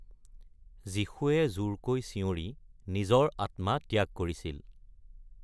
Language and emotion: Assamese, neutral